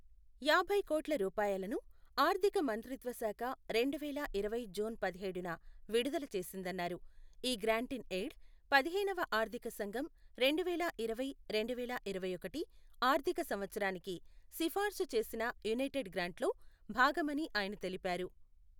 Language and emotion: Telugu, neutral